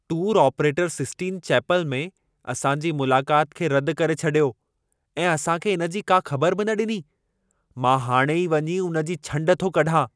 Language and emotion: Sindhi, angry